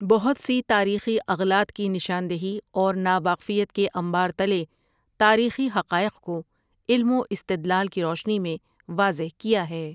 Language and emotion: Urdu, neutral